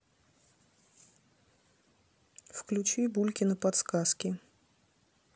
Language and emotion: Russian, neutral